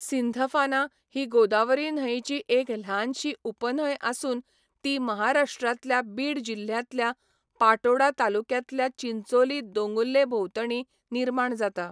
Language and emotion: Goan Konkani, neutral